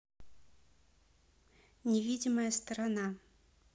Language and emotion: Russian, neutral